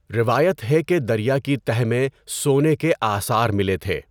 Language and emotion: Urdu, neutral